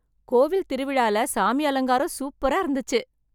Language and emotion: Tamil, happy